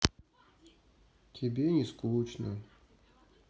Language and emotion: Russian, sad